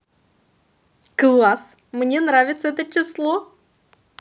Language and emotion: Russian, positive